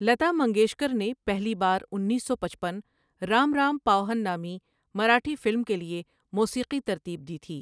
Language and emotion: Urdu, neutral